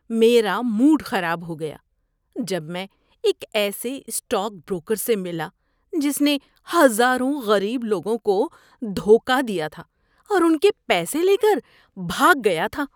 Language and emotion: Urdu, disgusted